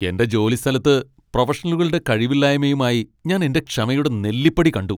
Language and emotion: Malayalam, angry